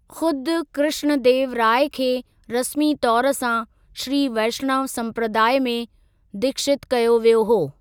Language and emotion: Sindhi, neutral